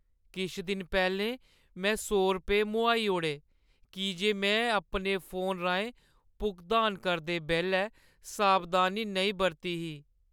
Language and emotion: Dogri, sad